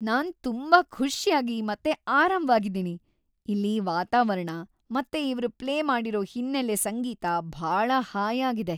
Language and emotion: Kannada, happy